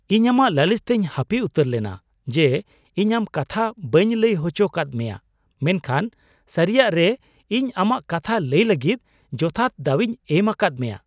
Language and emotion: Santali, surprised